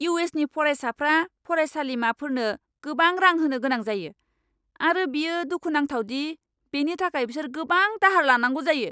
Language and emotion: Bodo, angry